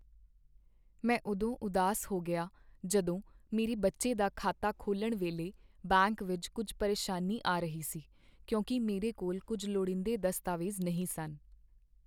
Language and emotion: Punjabi, sad